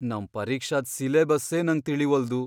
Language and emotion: Kannada, fearful